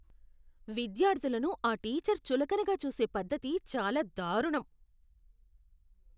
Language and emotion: Telugu, disgusted